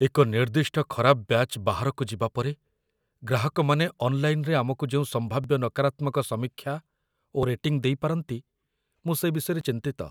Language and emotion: Odia, fearful